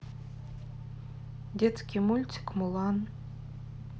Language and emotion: Russian, neutral